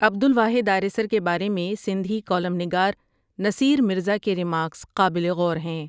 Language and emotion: Urdu, neutral